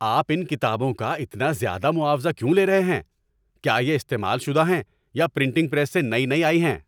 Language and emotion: Urdu, angry